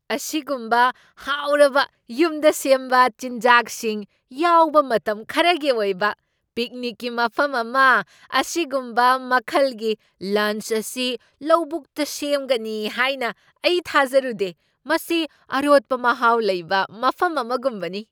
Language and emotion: Manipuri, surprised